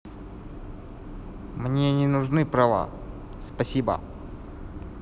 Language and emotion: Russian, neutral